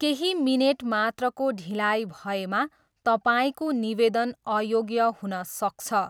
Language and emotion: Nepali, neutral